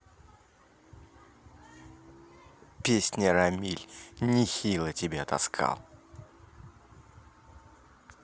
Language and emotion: Russian, angry